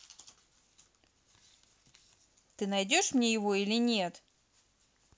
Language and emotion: Russian, angry